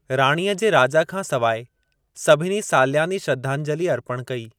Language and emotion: Sindhi, neutral